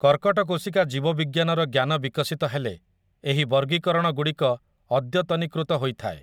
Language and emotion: Odia, neutral